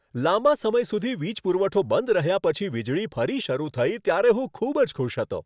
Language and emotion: Gujarati, happy